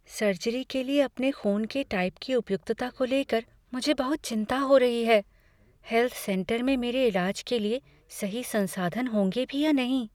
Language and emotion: Hindi, fearful